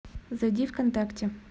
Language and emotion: Russian, neutral